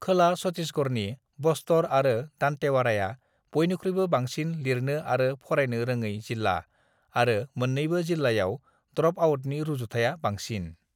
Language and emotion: Bodo, neutral